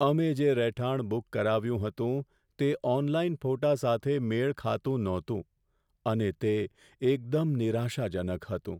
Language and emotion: Gujarati, sad